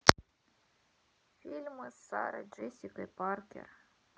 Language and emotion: Russian, sad